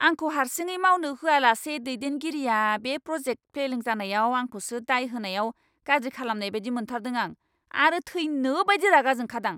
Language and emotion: Bodo, angry